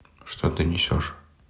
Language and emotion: Russian, neutral